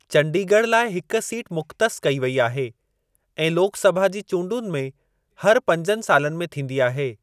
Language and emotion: Sindhi, neutral